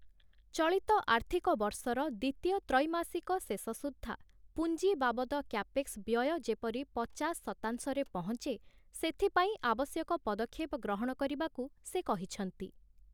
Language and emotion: Odia, neutral